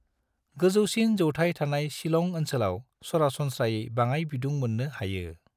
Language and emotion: Bodo, neutral